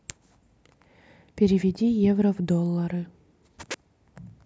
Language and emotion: Russian, neutral